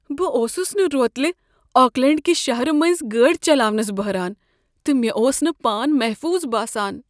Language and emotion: Kashmiri, fearful